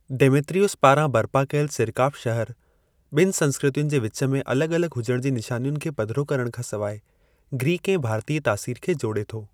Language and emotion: Sindhi, neutral